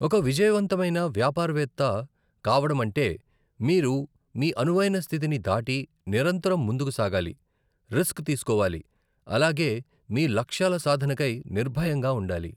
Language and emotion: Telugu, neutral